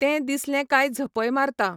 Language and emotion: Goan Konkani, neutral